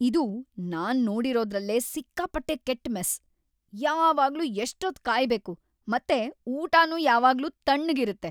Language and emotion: Kannada, angry